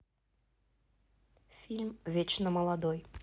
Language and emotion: Russian, neutral